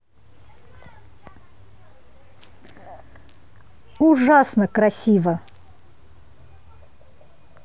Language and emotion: Russian, positive